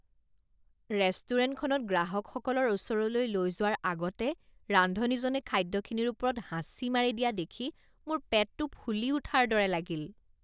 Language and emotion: Assamese, disgusted